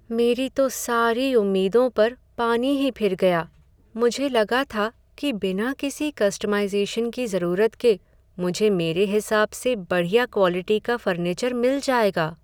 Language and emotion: Hindi, sad